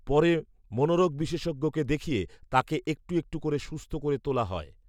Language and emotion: Bengali, neutral